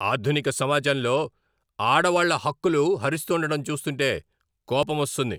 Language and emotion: Telugu, angry